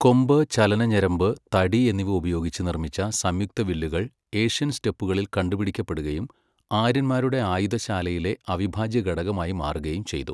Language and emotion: Malayalam, neutral